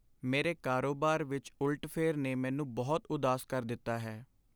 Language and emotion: Punjabi, sad